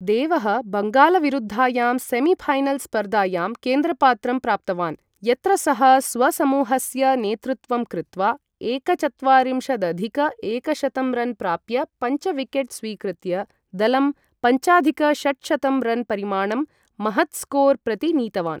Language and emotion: Sanskrit, neutral